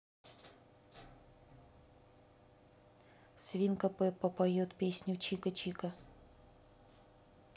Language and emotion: Russian, neutral